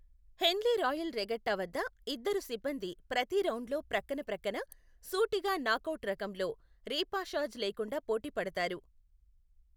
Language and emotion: Telugu, neutral